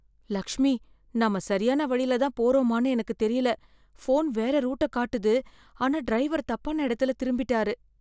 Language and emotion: Tamil, fearful